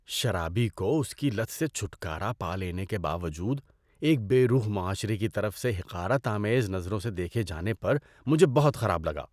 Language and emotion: Urdu, disgusted